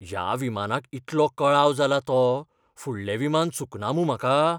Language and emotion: Goan Konkani, fearful